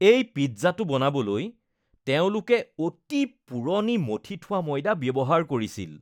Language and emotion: Assamese, disgusted